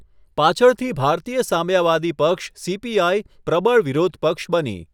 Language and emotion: Gujarati, neutral